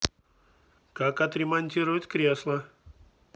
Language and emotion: Russian, neutral